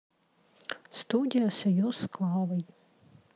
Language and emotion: Russian, neutral